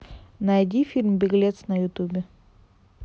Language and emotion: Russian, neutral